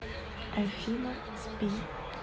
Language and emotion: Russian, neutral